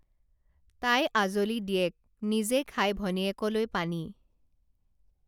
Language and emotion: Assamese, neutral